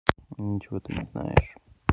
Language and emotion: Russian, sad